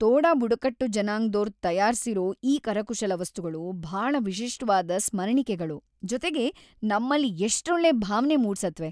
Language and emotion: Kannada, happy